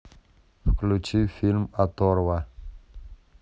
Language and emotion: Russian, neutral